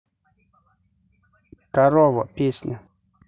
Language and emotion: Russian, neutral